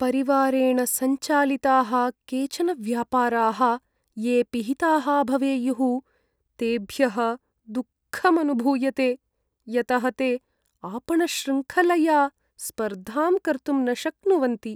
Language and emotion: Sanskrit, sad